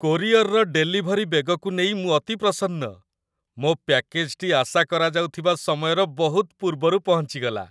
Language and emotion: Odia, happy